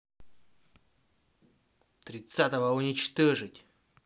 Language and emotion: Russian, angry